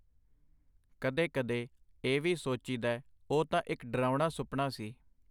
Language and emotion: Punjabi, neutral